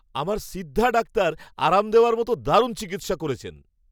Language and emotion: Bengali, happy